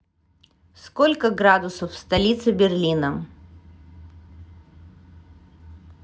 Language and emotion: Russian, neutral